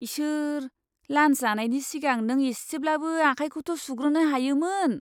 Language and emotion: Bodo, disgusted